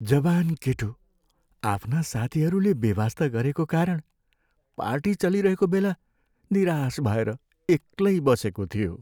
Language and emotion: Nepali, sad